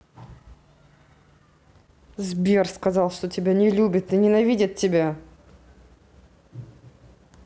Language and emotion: Russian, angry